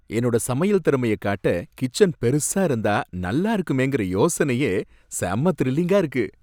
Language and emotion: Tamil, happy